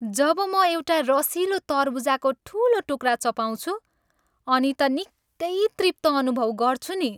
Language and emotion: Nepali, happy